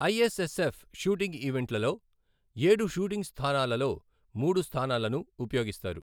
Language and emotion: Telugu, neutral